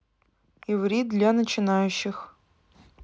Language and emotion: Russian, neutral